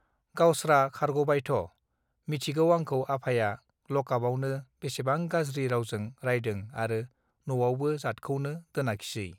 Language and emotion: Bodo, neutral